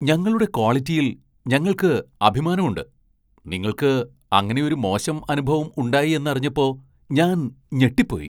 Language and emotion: Malayalam, surprised